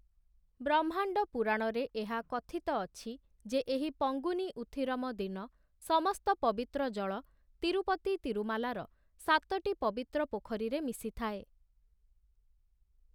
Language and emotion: Odia, neutral